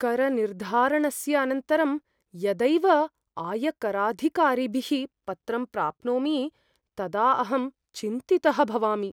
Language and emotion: Sanskrit, fearful